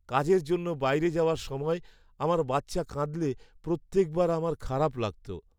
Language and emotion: Bengali, sad